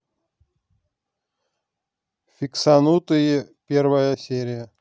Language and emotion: Russian, neutral